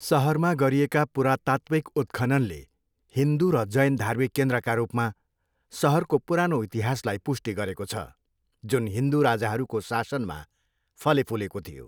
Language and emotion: Nepali, neutral